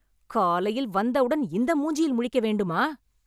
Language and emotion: Tamil, angry